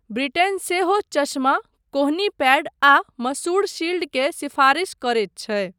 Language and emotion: Maithili, neutral